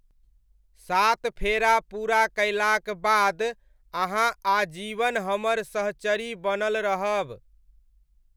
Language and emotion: Maithili, neutral